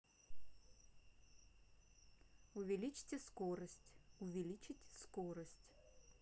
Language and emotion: Russian, neutral